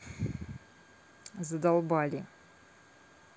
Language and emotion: Russian, angry